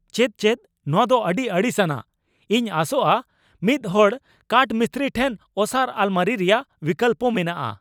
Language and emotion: Santali, angry